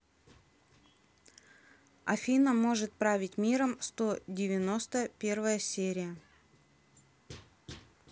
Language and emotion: Russian, neutral